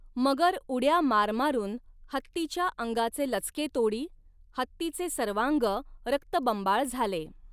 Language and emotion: Marathi, neutral